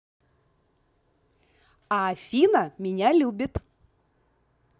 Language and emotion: Russian, positive